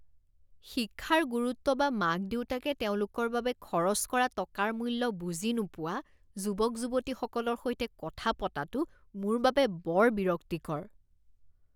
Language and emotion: Assamese, disgusted